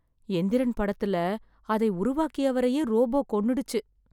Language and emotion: Tamil, sad